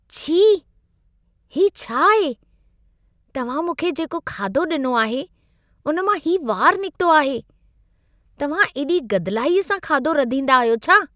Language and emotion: Sindhi, disgusted